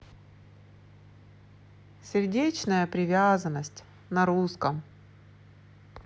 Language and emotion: Russian, sad